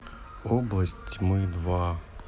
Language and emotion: Russian, sad